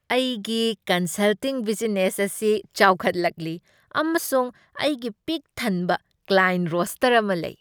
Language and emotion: Manipuri, happy